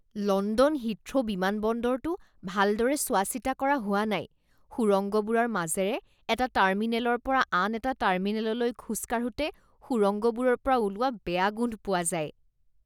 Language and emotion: Assamese, disgusted